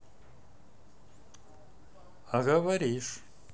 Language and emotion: Russian, neutral